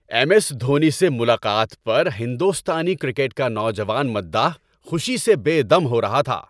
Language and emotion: Urdu, happy